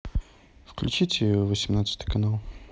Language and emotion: Russian, neutral